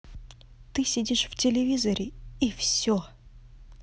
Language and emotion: Russian, angry